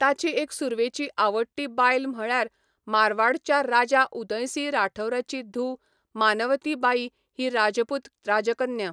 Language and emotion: Goan Konkani, neutral